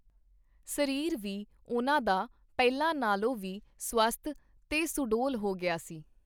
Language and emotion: Punjabi, neutral